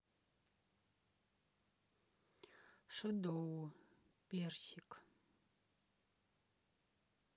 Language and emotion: Russian, neutral